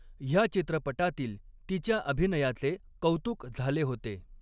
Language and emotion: Marathi, neutral